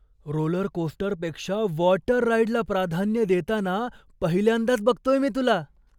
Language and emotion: Marathi, surprised